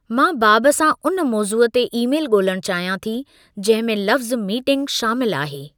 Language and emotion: Sindhi, neutral